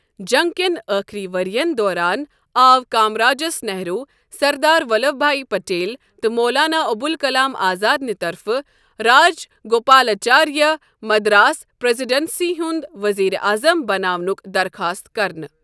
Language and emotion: Kashmiri, neutral